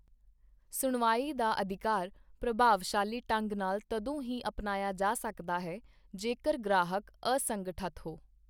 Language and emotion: Punjabi, neutral